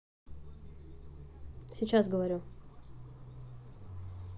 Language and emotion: Russian, neutral